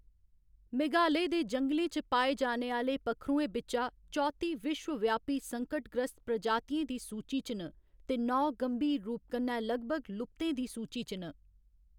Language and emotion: Dogri, neutral